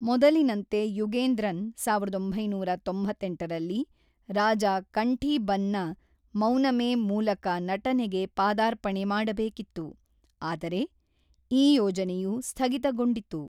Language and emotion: Kannada, neutral